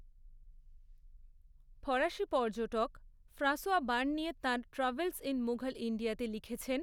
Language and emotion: Bengali, neutral